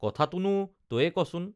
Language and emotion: Assamese, neutral